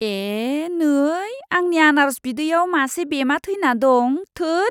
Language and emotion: Bodo, disgusted